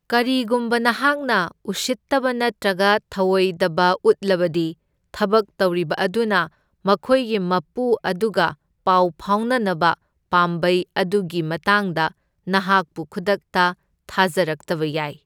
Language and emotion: Manipuri, neutral